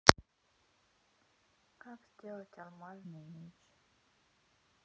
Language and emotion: Russian, sad